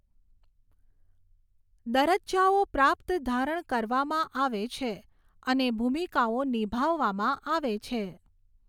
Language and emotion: Gujarati, neutral